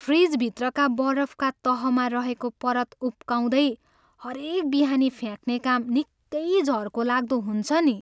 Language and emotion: Nepali, sad